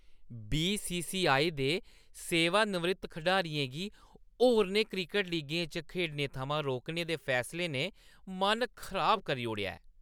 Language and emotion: Dogri, disgusted